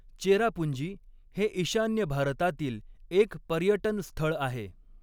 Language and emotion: Marathi, neutral